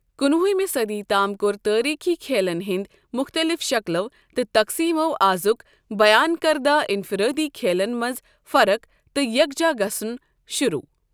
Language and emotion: Kashmiri, neutral